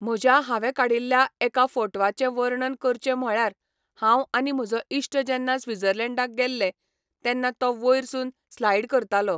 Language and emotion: Goan Konkani, neutral